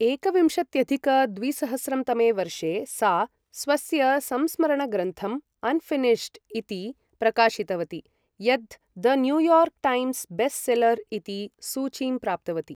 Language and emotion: Sanskrit, neutral